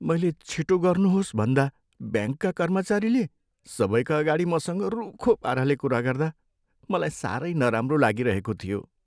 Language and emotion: Nepali, sad